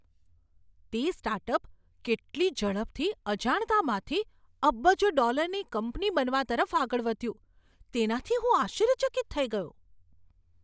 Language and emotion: Gujarati, surprised